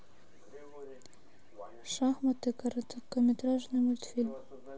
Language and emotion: Russian, neutral